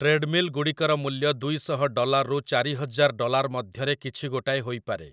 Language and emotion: Odia, neutral